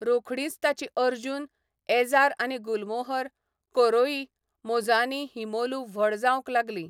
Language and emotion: Goan Konkani, neutral